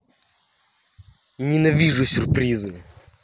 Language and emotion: Russian, angry